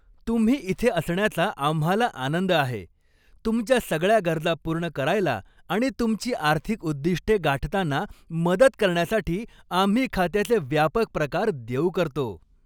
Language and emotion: Marathi, happy